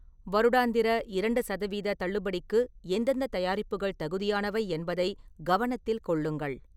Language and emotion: Tamil, neutral